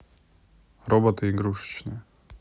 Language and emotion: Russian, neutral